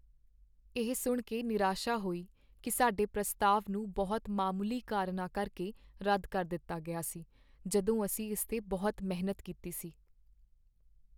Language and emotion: Punjabi, sad